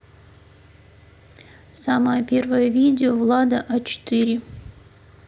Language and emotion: Russian, neutral